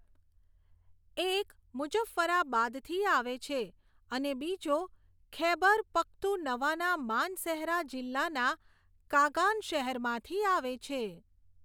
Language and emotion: Gujarati, neutral